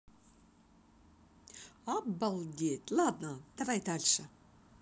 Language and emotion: Russian, positive